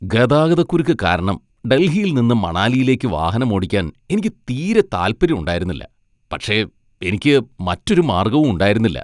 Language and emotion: Malayalam, disgusted